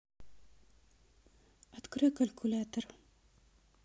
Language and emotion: Russian, neutral